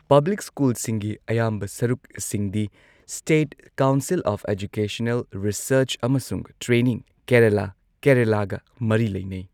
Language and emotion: Manipuri, neutral